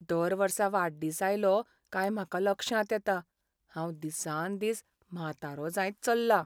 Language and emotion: Goan Konkani, sad